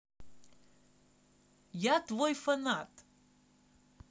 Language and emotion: Russian, positive